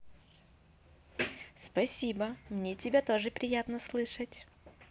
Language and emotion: Russian, positive